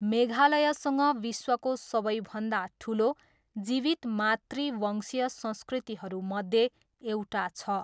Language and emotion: Nepali, neutral